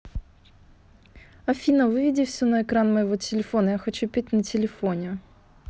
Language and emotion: Russian, neutral